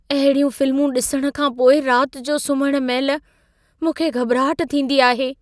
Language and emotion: Sindhi, fearful